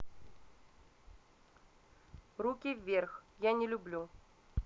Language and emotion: Russian, neutral